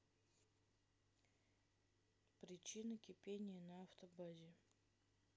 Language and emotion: Russian, neutral